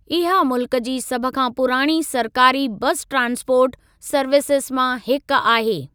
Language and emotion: Sindhi, neutral